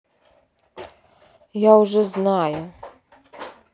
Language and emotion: Russian, neutral